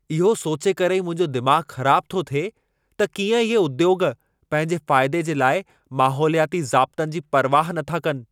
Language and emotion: Sindhi, angry